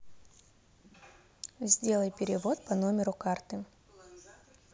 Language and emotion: Russian, neutral